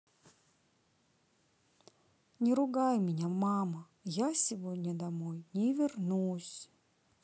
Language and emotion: Russian, sad